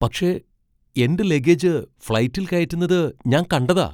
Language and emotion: Malayalam, surprised